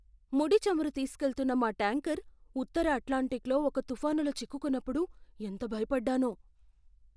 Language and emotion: Telugu, fearful